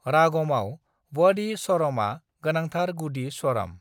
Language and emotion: Bodo, neutral